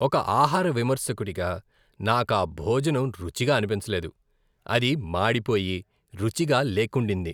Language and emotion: Telugu, disgusted